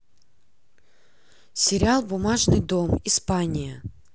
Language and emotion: Russian, neutral